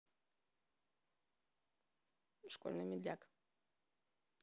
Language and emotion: Russian, neutral